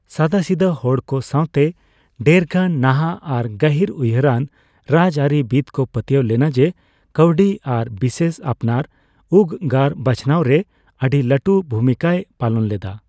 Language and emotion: Santali, neutral